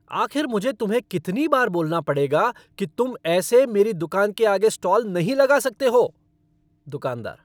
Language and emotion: Hindi, angry